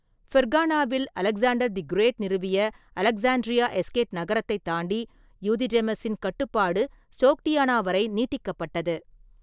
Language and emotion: Tamil, neutral